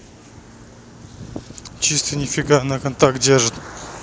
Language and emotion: Russian, neutral